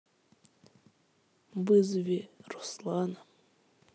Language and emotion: Russian, sad